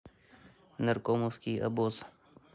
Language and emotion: Russian, neutral